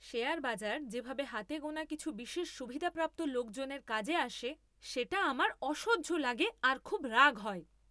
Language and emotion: Bengali, angry